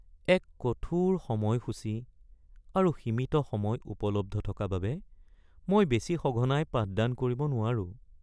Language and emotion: Assamese, sad